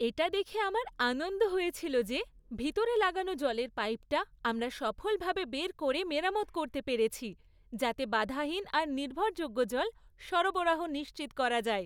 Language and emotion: Bengali, happy